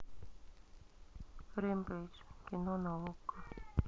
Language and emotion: Russian, neutral